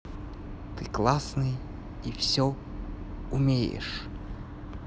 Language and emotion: Russian, positive